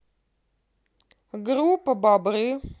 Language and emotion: Russian, neutral